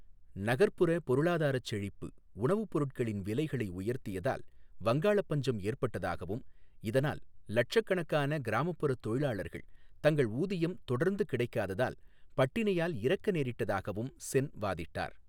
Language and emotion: Tamil, neutral